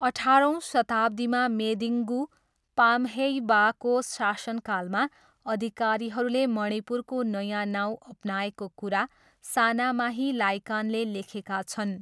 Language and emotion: Nepali, neutral